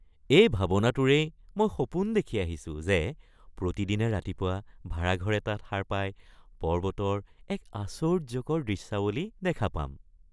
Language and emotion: Assamese, happy